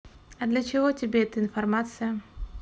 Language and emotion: Russian, neutral